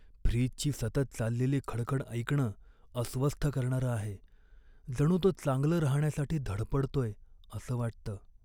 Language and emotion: Marathi, sad